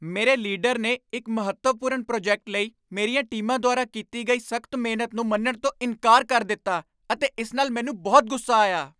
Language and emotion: Punjabi, angry